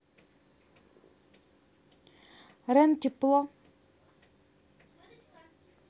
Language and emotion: Russian, neutral